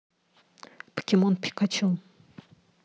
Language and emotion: Russian, neutral